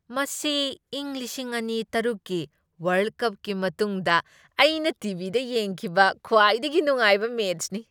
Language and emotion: Manipuri, happy